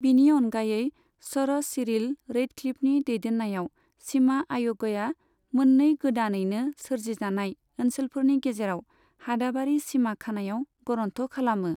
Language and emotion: Bodo, neutral